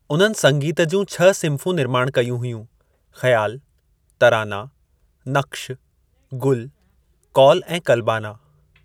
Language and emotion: Sindhi, neutral